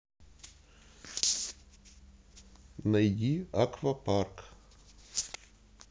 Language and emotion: Russian, neutral